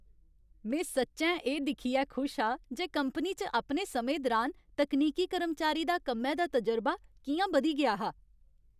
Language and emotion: Dogri, happy